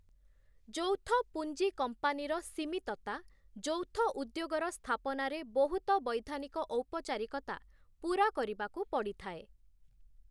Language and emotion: Odia, neutral